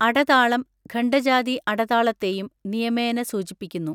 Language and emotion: Malayalam, neutral